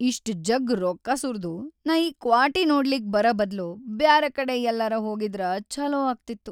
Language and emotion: Kannada, sad